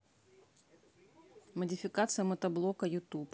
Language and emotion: Russian, neutral